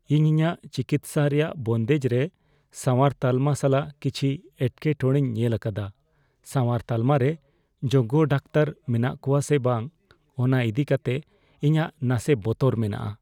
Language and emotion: Santali, fearful